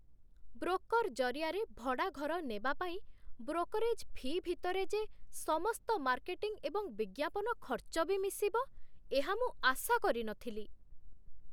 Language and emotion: Odia, surprised